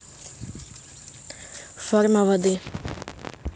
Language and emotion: Russian, neutral